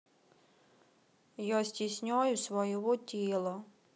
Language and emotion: Russian, sad